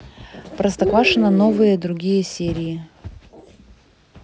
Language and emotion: Russian, neutral